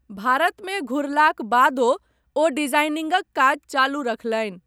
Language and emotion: Maithili, neutral